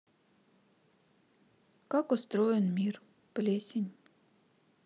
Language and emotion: Russian, sad